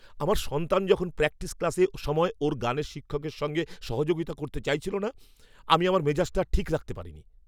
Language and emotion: Bengali, angry